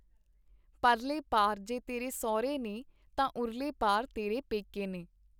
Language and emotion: Punjabi, neutral